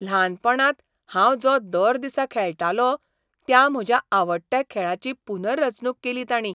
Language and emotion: Goan Konkani, surprised